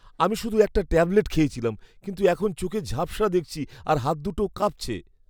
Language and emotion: Bengali, fearful